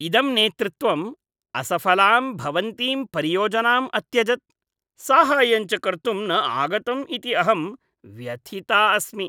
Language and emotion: Sanskrit, disgusted